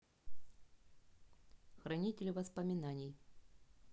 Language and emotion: Russian, neutral